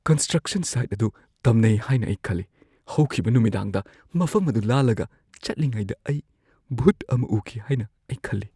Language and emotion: Manipuri, fearful